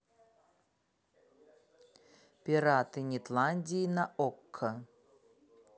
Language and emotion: Russian, neutral